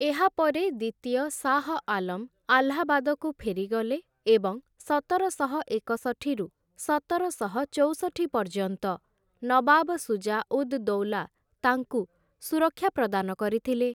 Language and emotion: Odia, neutral